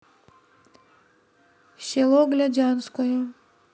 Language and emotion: Russian, neutral